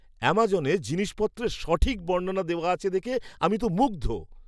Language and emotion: Bengali, surprised